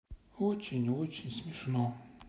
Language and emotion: Russian, sad